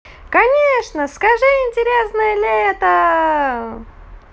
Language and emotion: Russian, positive